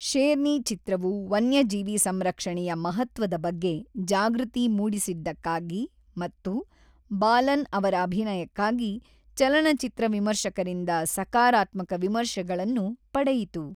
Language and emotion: Kannada, neutral